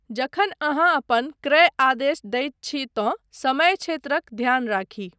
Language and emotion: Maithili, neutral